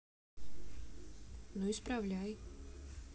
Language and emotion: Russian, neutral